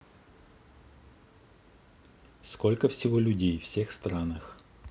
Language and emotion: Russian, neutral